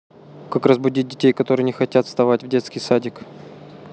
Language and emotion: Russian, neutral